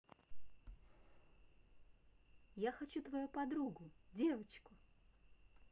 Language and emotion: Russian, positive